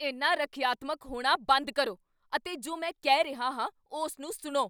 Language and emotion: Punjabi, angry